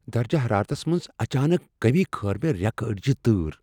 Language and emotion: Kashmiri, fearful